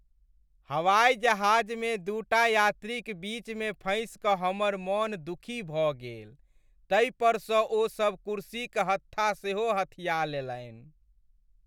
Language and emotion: Maithili, sad